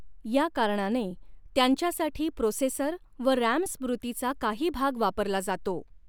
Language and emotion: Marathi, neutral